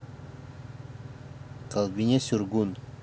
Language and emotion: Russian, neutral